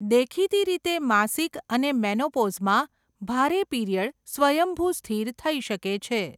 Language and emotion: Gujarati, neutral